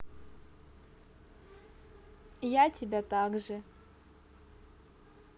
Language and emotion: Russian, neutral